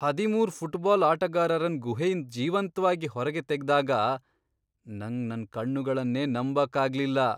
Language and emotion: Kannada, surprised